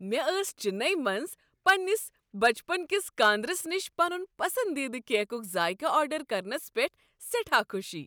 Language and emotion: Kashmiri, happy